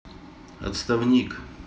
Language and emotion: Russian, neutral